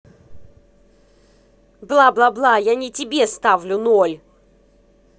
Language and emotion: Russian, angry